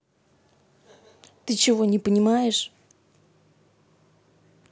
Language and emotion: Russian, angry